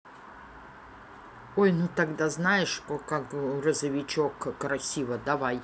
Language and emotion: Russian, neutral